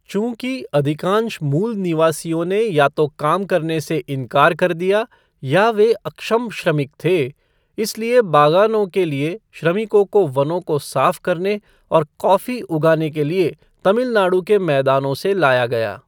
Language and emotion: Hindi, neutral